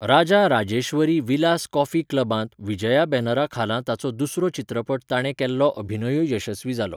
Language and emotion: Goan Konkani, neutral